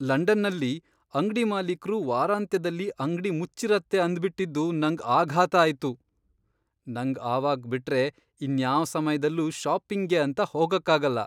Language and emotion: Kannada, surprised